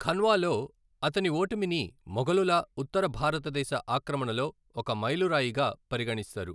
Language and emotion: Telugu, neutral